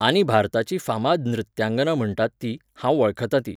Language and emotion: Goan Konkani, neutral